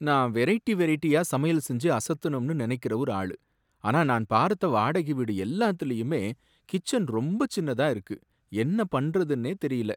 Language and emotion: Tamil, sad